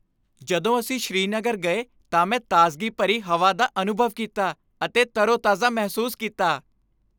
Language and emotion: Punjabi, happy